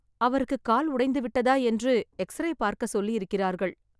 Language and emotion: Tamil, sad